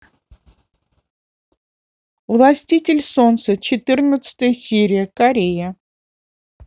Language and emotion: Russian, neutral